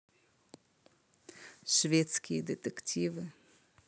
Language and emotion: Russian, neutral